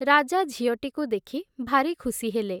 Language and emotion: Odia, neutral